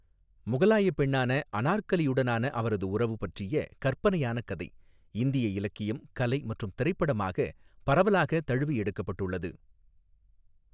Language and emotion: Tamil, neutral